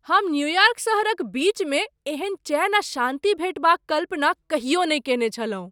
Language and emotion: Maithili, surprised